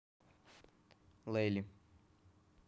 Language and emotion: Russian, neutral